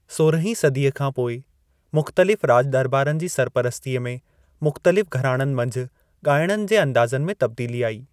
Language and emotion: Sindhi, neutral